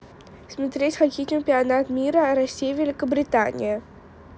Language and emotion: Russian, neutral